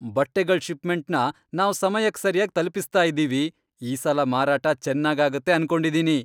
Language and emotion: Kannada, happy